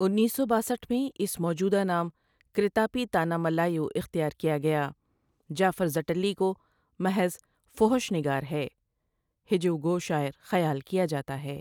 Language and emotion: Urdu, neutral